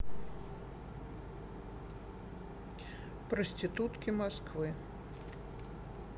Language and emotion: Russian, neutral